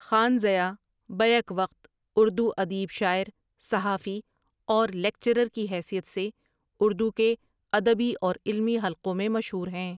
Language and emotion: Urdu, neutral